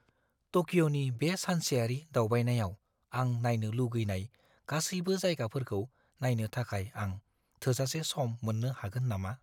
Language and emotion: Bodo, fearful